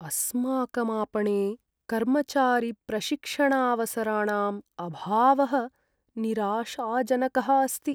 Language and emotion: Sanskrit, sad